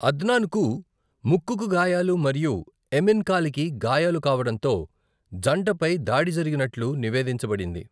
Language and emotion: Telugu, neutral